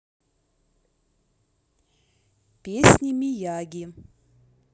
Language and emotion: Russian, neutral